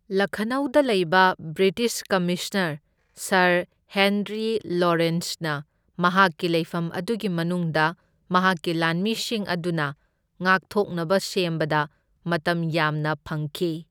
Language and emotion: Manipuri, neutral